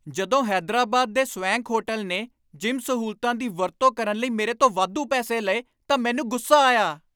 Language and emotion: Punjabi, angry